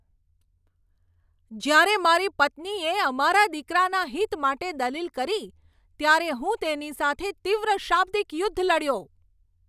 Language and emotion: Gujarati, angry